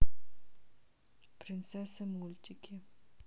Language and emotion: Russian, neutral